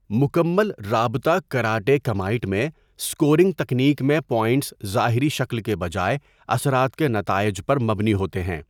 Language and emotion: Urdu, neutral